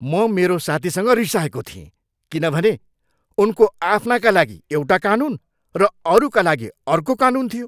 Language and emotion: Nepali, angry